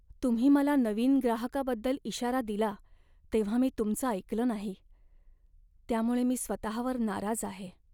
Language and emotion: Marathi, sad